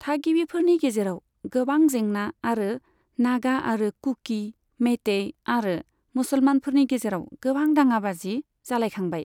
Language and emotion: Bodo, neutral